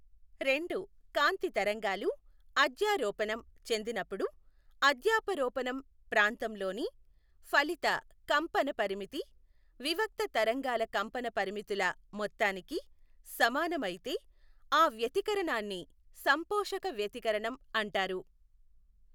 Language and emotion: Telugu, neutral